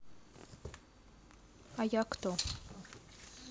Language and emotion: Russian, neutral